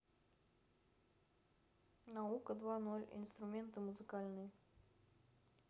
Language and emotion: Russian, neutral